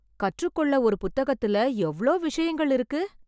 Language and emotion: Tamil, surprised